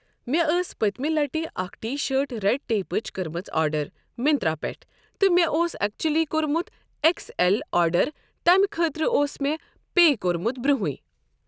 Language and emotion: Kashmiri, neutral